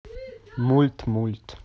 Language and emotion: Russian, neutral